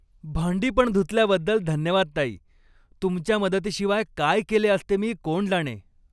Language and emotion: Marathi, happy